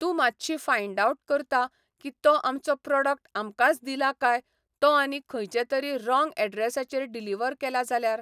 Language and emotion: Goan Konkani, neutral